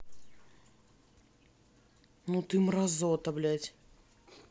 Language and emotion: Russian, angry